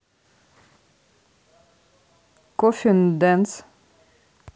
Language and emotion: Russian, neutral